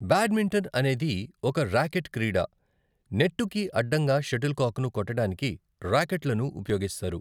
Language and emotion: Telugu, neutral